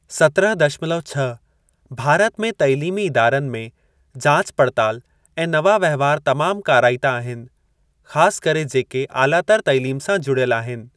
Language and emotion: Sindhi, neutral